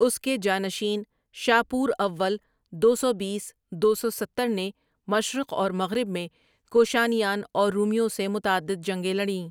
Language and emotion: Urdu, neutral